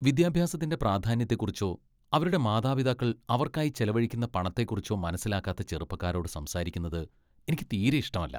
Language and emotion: Malayalam, disgusted